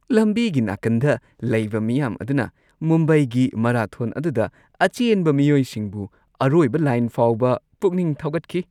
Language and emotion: Manipuri, happy